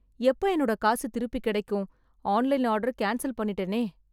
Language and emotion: Tamil, sad